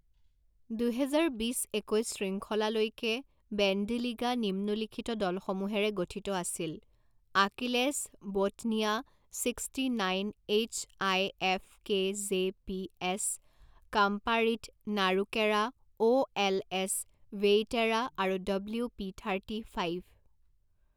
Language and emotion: Assamese, neutral